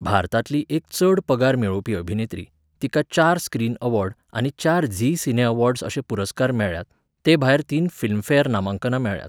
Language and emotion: Goan Konkani, neutral